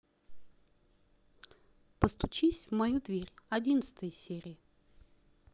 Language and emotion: Russian, neutral